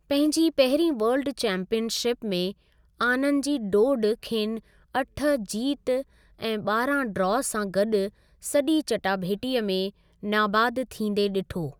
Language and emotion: Sindhi, neutral